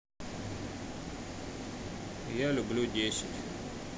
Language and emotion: Russian, neutral